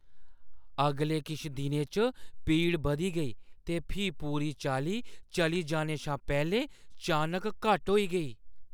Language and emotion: Dogri, surprised